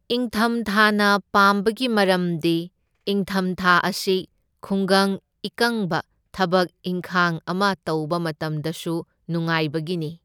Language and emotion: Manipuri, neutral